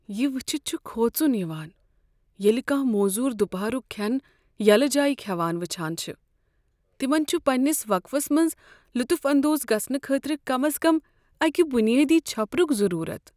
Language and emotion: Kashmiri, sad